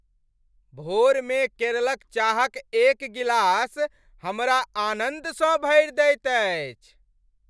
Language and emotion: Maithili, happy